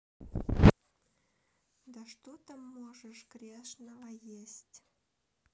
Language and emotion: Russian, neutral